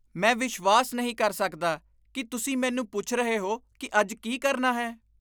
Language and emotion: Punjabi, disgusted